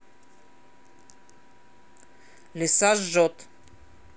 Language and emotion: Russian, neutral